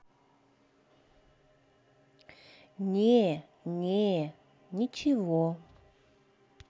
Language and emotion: Russian, neutral